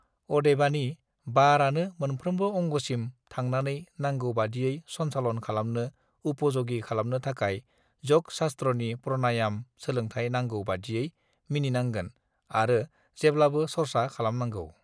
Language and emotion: Bodo, neutral